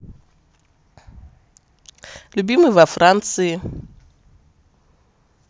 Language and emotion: Russian, positive